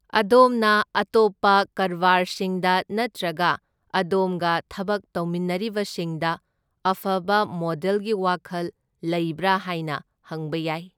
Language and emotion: Manipuri, neutral